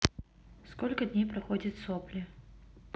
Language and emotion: Russian, neutral